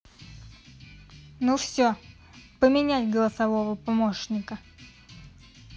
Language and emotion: Russian, neutral